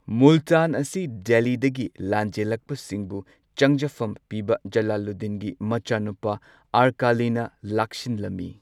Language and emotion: Manipuri, neutral